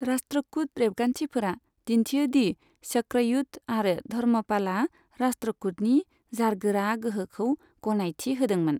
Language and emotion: Bodo, neutral